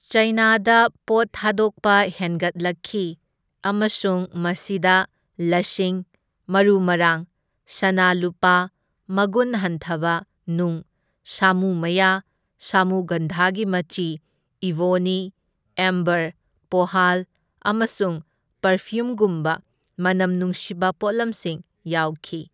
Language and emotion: Manipuri, neutral